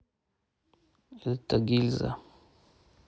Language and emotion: Russian, neutral